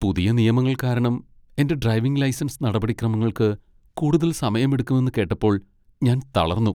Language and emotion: Malayalam, sad